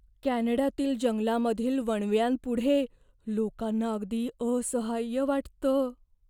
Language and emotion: Marathi, fearful